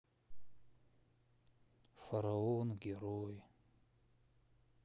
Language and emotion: Russian, sad